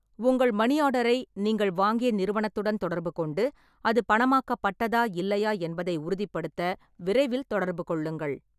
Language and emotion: Tamil, neutral